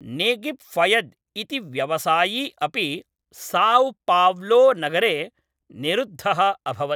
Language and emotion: Sanskrit, neutral